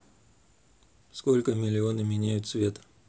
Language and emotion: Russian, neutral